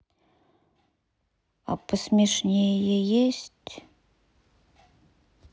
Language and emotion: Russian, sad